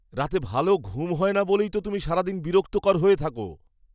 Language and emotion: Bengali, angry